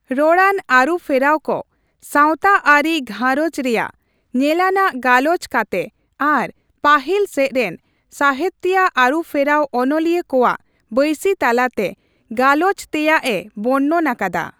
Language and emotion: Santali, neutral